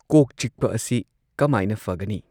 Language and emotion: Manipuri, neutral